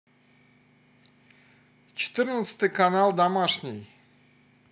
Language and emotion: Russian, neutral